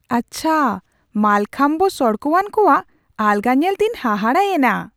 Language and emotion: Santali, surprised